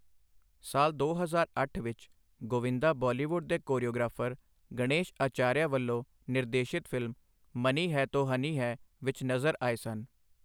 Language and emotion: Punjabi, neutral